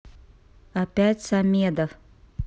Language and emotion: Russian, neutral